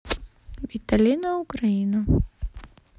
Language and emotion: Russian, neutral